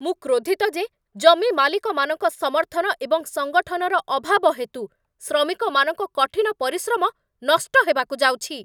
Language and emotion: Odia, angry